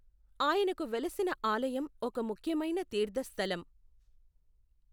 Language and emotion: Telugu, neutral